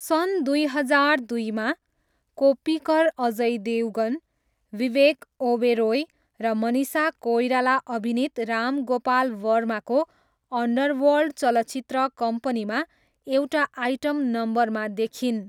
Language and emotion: Nepali, neutral